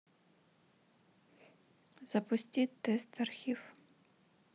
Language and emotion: Russian, neutral